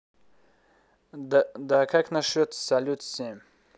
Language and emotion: Russian, neutral